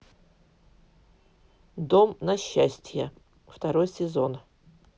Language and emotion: Russian, neutral